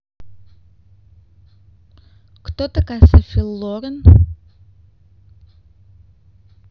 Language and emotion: Russian, neutral